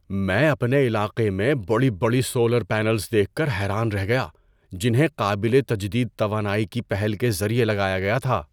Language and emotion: Urdu, surprised